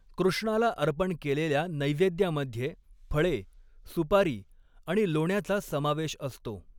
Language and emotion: Marathi, neutral